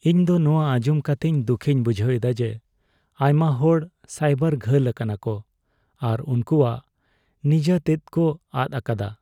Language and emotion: Santali, sad